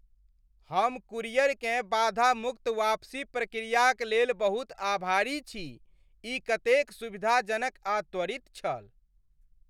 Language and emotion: Maithili, happy